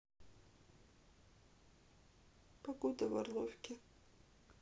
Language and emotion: Russian, sad